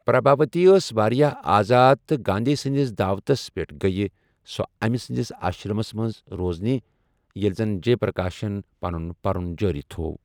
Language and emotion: Kashmiri, neutral